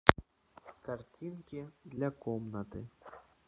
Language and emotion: Russian, neutral